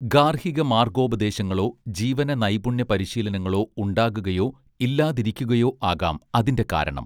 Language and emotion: Malayalam, neutral